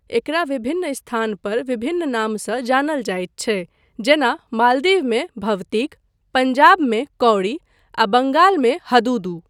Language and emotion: Maithili, neutral